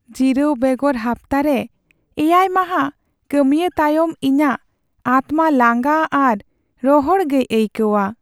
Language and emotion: Santali, sad